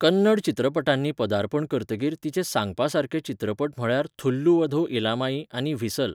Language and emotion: Goan Konkani, neutral